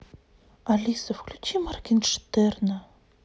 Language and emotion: Russian, sad